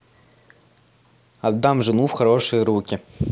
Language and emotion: Russian, neutral